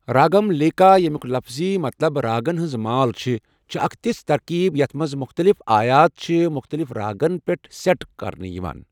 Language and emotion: Kashmiri, neutral